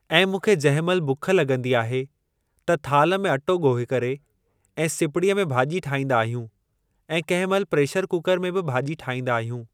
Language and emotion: Sindhi, neutral